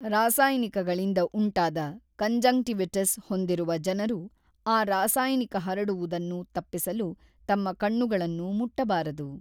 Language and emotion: Kannada, neutral